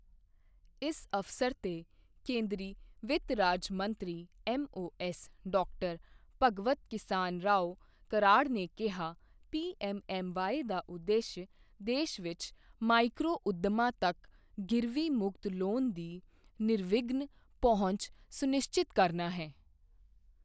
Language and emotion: Punjabi, neutral